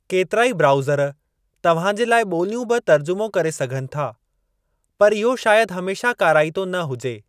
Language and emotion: Sindhi, neutral